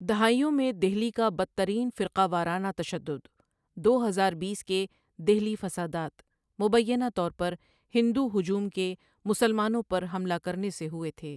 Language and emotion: Urdu, neutral